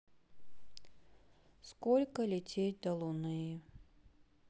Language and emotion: Russian, sad